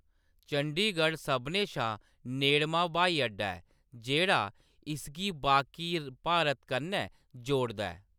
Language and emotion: Dogri, neutral